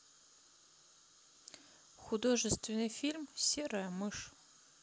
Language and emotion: Russian, neutral